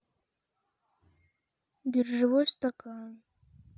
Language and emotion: Russian, sad